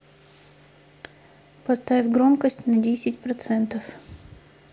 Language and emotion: Russian, neutral